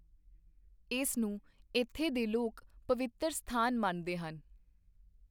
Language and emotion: Punjabi, neutral